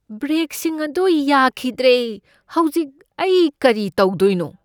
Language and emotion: Manipuri, fearful